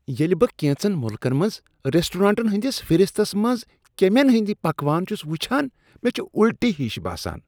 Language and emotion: Kashmiri, disgusted